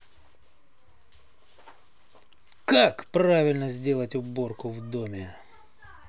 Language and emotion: Russian, angry